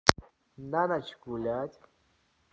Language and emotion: Russian, neutral